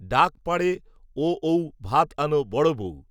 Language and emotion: Bengali, neutral